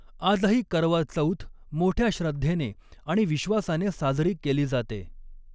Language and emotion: Marathi, neutral